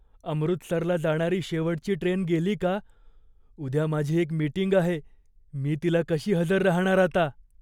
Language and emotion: Marathi, fearful